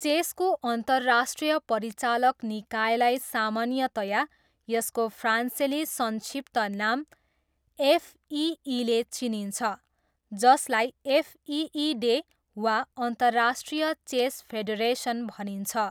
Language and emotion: Nepali, neutral